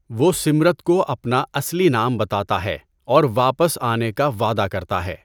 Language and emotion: Urdu, neutral